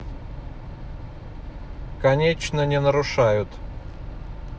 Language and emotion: Russian, neutral